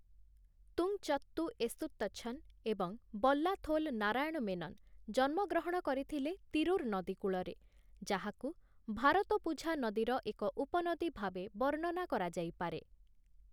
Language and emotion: Odia, neutral